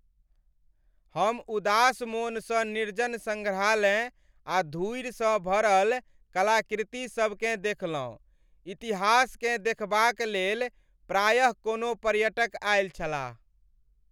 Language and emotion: Maithili, sad